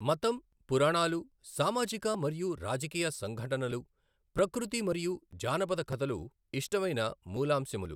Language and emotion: Telugu, neutral